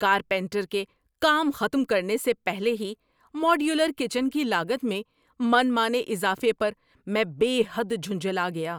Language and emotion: Urdu, angry